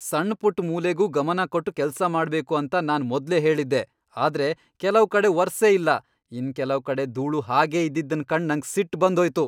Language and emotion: Kannada, angry